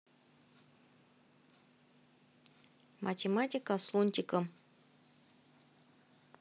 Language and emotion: Russian, neutral